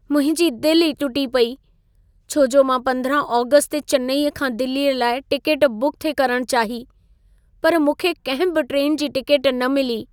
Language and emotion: Sindhi, sad